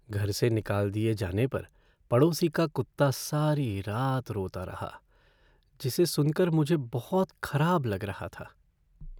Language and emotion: Hindi, sad